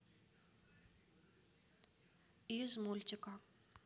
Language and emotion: Russian, neutral